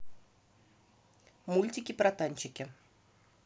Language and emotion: Russian, neutral